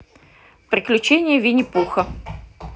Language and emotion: Russian, neutral